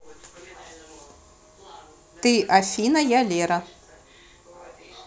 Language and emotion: Russian, neutral